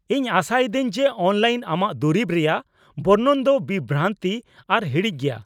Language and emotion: Santali, angry